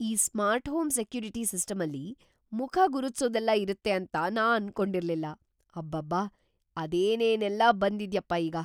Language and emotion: Kannada, surprised